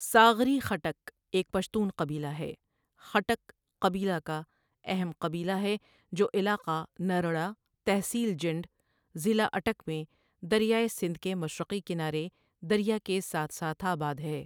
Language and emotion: Urdu, neutral